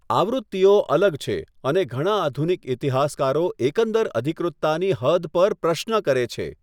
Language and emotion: Gujarati, neutral